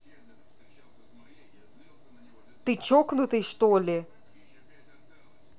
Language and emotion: Russian, angry